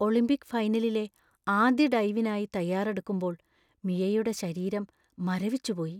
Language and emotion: Malayalam, fearful